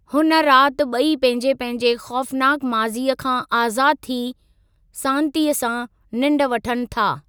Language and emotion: Sindhi, neutral